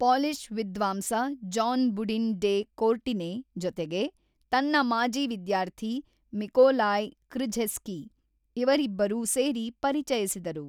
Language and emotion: Kannada, neutral